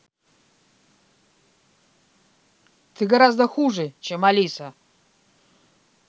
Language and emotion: Russian, angry